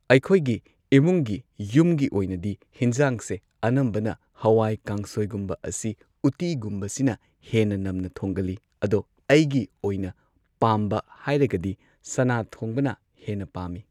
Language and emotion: Manipuri, neutral